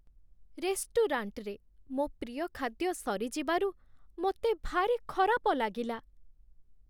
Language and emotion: Odia, sad